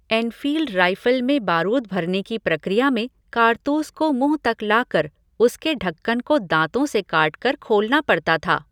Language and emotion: Hindi, neutral